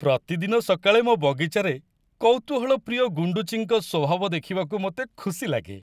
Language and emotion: Odia, happy